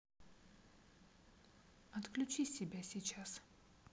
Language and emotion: Russian, neutral